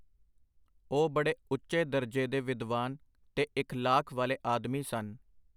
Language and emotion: Punjabi, neutral